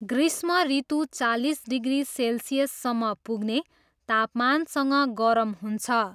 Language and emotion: Nepali, neutral